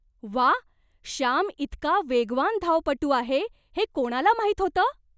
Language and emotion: Marathi, surprised